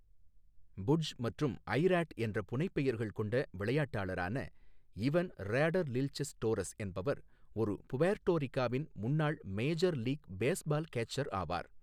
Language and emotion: Tamil, neutral